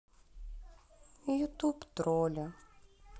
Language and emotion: Russian, sad